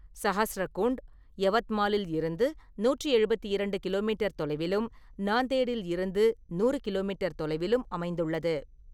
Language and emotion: Tamil, neutral